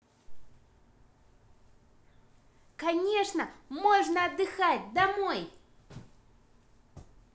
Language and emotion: Russian, positive